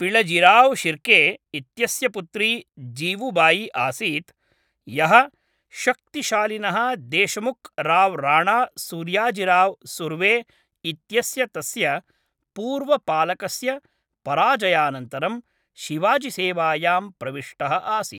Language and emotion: Sanskrit, neutral